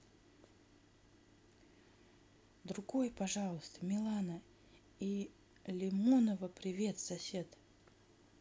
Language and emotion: Russian, neutral